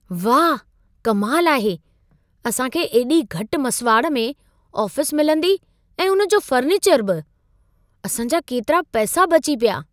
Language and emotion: Sindhi, surprised